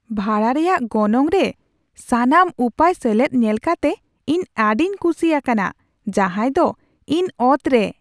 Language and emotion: Santali, surprised